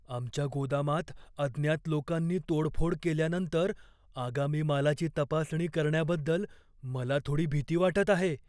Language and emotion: Marathi, fearful